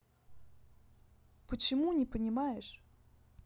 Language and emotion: Russian, neutral